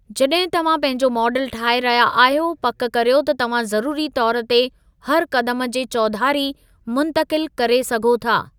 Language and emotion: Sindhi, neutral